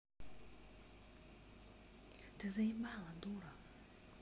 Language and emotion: Russian, angry